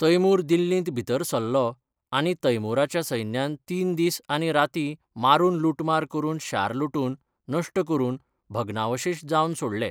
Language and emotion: Goan Konkani, neutral